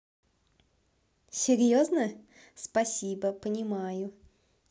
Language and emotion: Russian, positive